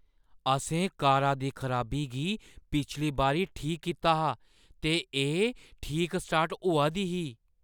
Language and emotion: Dogri, surprised